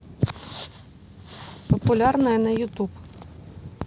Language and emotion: Russian, neutral